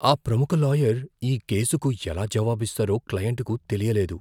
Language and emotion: Telugu, fearful